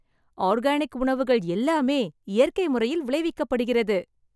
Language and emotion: Tamil, happy